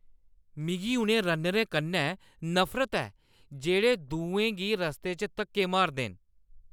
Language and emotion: Dogri, angry